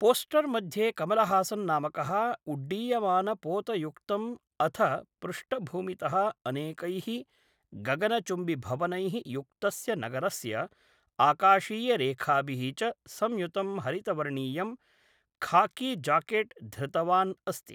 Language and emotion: Sanskrit, neutral